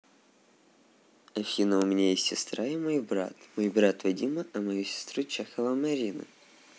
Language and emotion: Russian, neutral